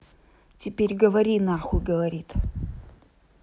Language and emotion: Russian, angry